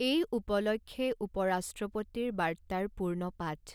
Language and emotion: Assamese, neutral